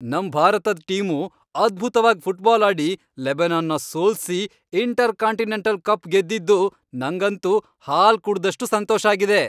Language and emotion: Kannada, happy